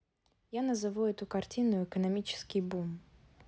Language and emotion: Russian, neutral